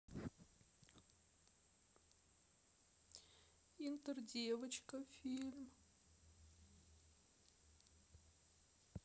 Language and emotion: Russian, sad